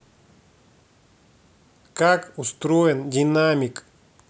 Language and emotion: Russian, angry